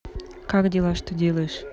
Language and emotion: Russian, neutral